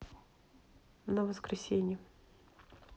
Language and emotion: Russian, neutral